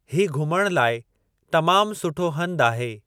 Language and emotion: Sindhi, neutral